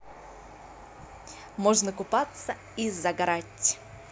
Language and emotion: Russian, positive